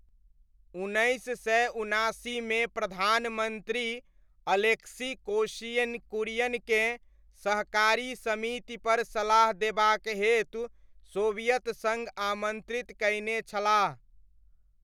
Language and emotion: Maithili, neutral